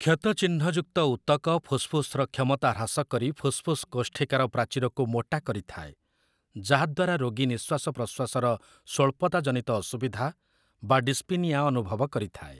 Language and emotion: Odia, neutral